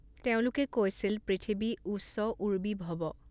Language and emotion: Assamese, neutral